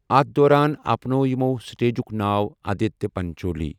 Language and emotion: Kashmiri, neutral